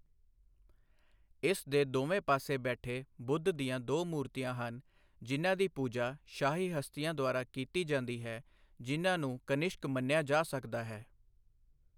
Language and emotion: Punjabi, neutral